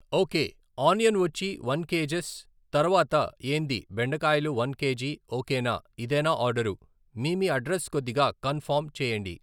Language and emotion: Telugu, neutral